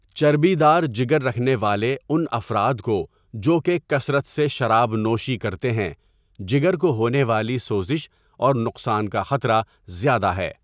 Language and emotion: Urdu, neutral